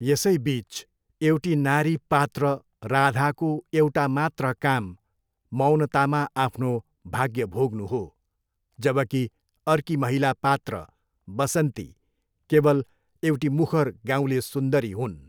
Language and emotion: Nepali, neutral